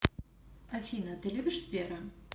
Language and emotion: Russian, neutral